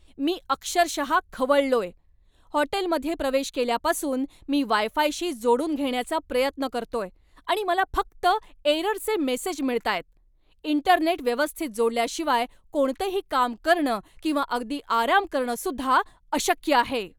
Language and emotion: Marathi, angry